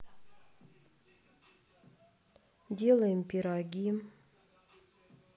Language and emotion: Russian, sad